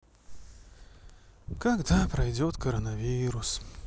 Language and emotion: Russian, sad